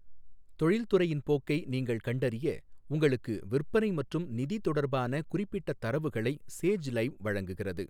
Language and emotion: Tamil, neutral